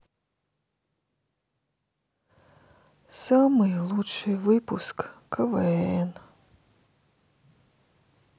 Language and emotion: Russian, sad